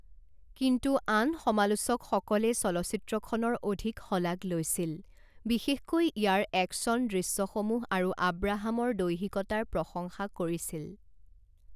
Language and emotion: Assamese, neutral